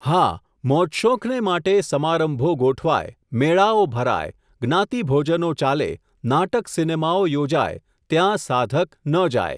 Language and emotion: Gujarati, neutral